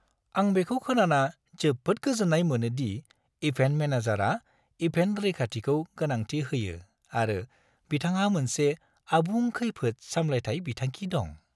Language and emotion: Bodo, happy